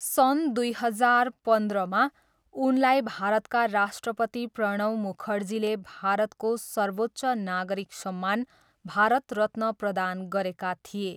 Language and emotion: Nepali, neutral